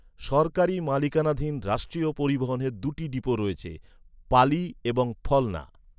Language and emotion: Bengali, neutral